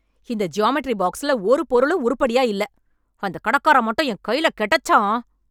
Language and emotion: Tamil, angry